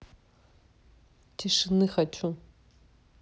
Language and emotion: Russian, neutral